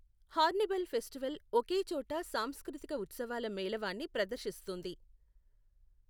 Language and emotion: Telugu, neutral